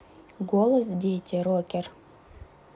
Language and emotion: Russian, neutral